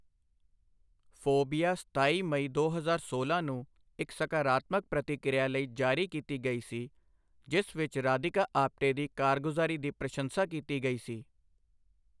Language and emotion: Punjabi, neutral